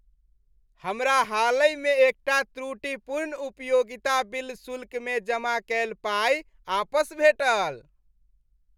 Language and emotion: Maithili, happy